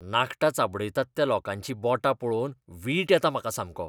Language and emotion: Goan Konkani, disgusted